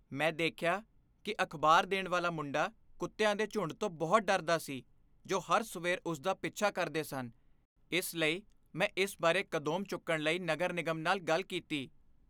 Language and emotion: Punjabi, fearful